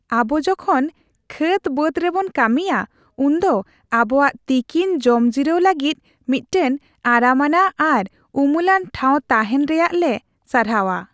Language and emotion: Santali, happy